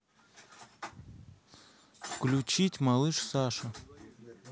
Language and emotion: Russian, neutral